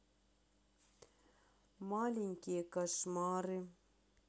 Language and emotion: Russian, sad